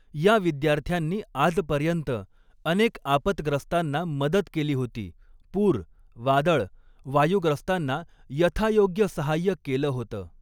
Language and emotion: Marathi, neutral